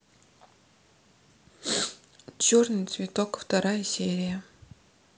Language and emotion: Russian, neutral